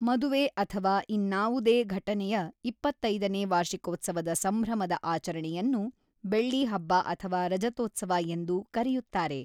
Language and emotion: Kannada, neutral